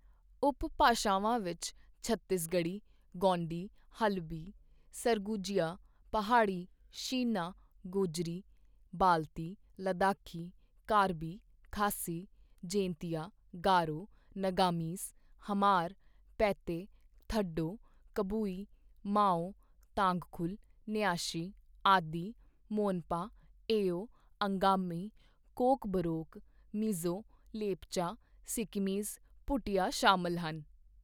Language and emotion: Punjabi, neutral